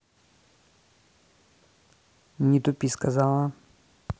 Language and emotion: Russian, neutral